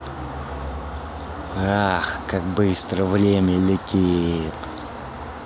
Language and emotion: Russian, angry